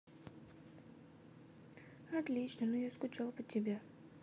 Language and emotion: Russian, sad